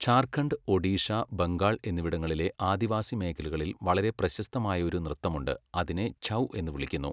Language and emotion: Malayalam, neutral